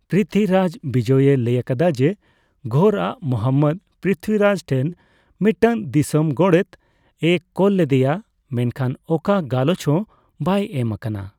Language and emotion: Santali, neutral